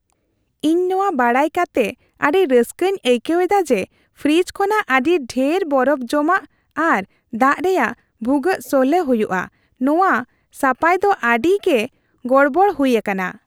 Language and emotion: Santali, happy